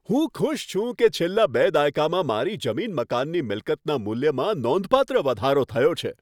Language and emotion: Gujarati, happy